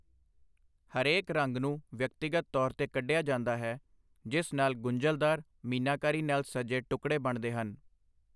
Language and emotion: Punjabi, neutral